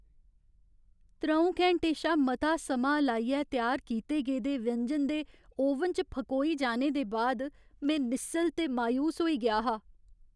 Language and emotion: Dogri, sad